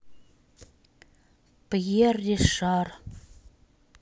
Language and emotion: Russian, neutral